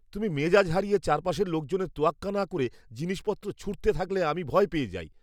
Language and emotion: Bengali, fearful